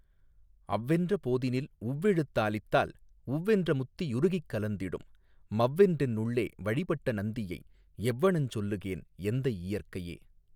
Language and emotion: Tamil, neutral